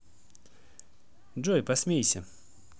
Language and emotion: Russian, positive